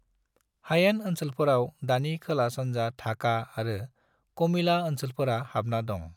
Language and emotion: Bodo, neutral